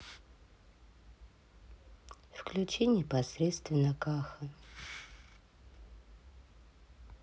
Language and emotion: Russian, sad